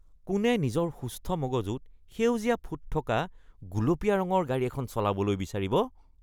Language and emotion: Assamese, disgusted